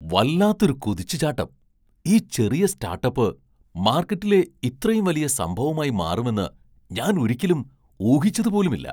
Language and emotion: Malayalam, surprised